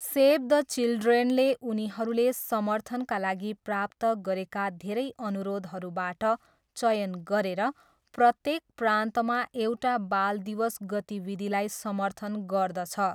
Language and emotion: Nepali, neutral